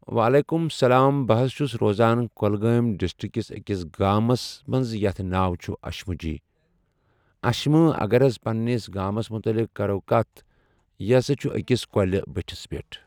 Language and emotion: Kashmiri, neutral